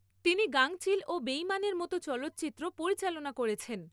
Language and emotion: Bengali, neutral